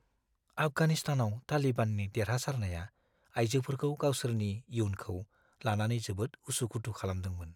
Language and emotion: Bodo, fearful